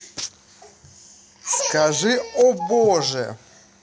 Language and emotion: Russian, positive